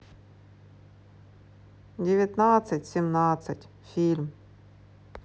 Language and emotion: Russian, sad